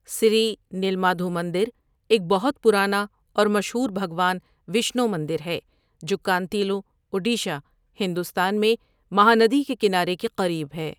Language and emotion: Urdu, neutral